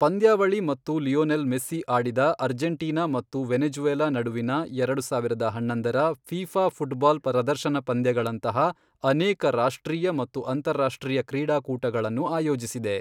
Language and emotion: Kannada, neutral